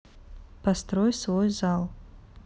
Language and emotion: Russian, neutral